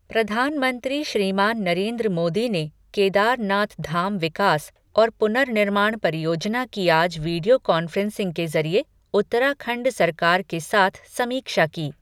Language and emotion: Hindi, neutral